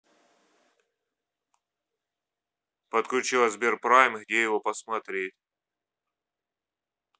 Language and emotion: Russian, neutral